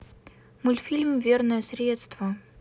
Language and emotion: Russian, neutral